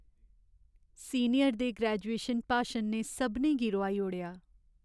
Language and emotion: Dogri, sad